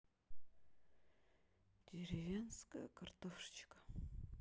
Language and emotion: Russian, sad